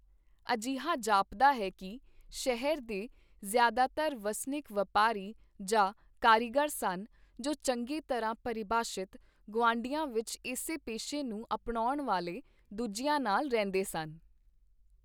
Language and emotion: Punjabi, neutral